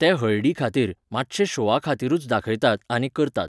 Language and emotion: Goan Konkani, neutral